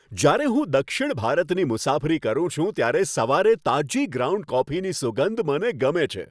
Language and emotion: Gujarati, happy